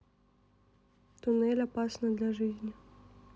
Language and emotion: Russian, neutral